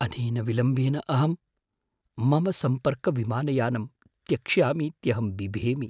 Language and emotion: Sanskrit, fearful